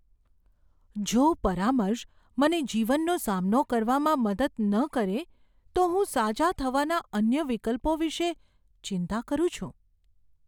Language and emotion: Gujarati, fearful